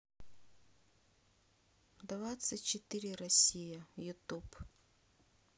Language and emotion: Russian, neutral